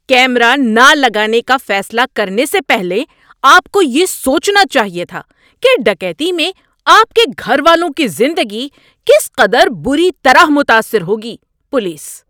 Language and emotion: Urdu, angry